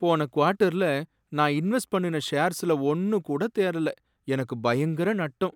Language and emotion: Tamil, sad